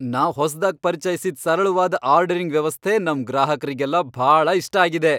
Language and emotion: Kannada, happy